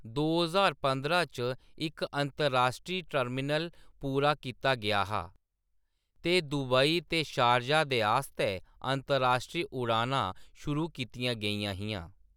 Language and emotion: Dogri, neutral